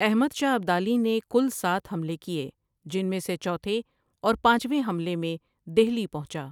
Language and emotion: Urdu, neutral